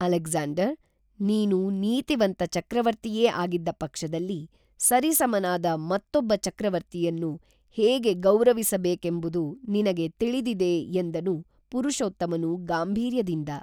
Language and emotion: Kannada, neutral